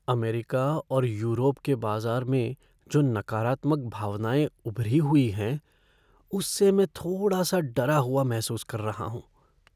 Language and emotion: Hindi, fearful